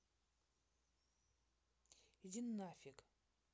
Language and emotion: Russian, angry